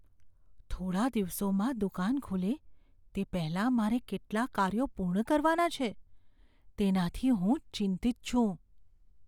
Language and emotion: Gujarati, fearful